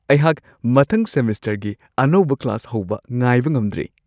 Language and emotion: Manipuri, happy